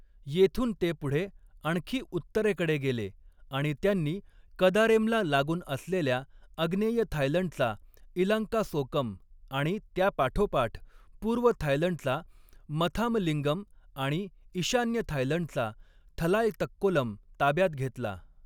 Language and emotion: Marathi, neutral